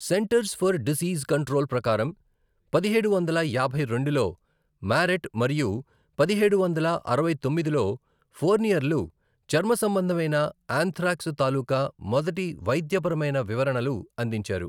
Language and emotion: Telugu, neutral